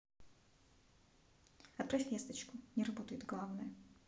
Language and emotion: Russian, neutral